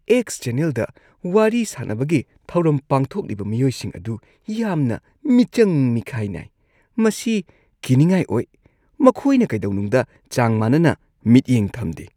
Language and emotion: Manipuri, disgusted